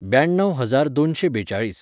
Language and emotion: Goan Konkani, neutral